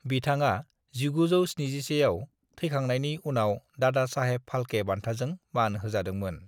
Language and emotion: Bodo, neutral